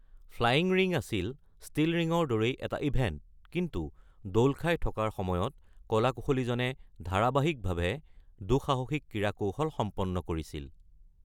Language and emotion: Assamese, neutral